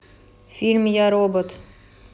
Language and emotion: Russian, neutral